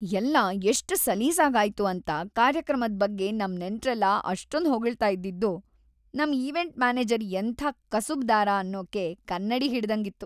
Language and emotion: Kannada, happy